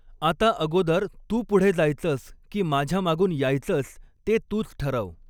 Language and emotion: Marathi, neutral